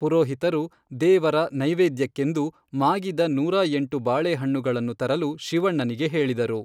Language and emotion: Kannada, neutral